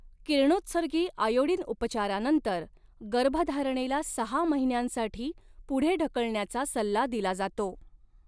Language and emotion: Marathi, neutral